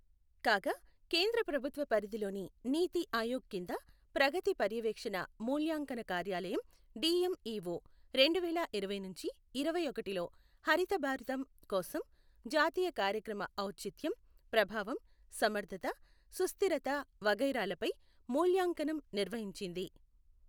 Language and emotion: Telugu, neutral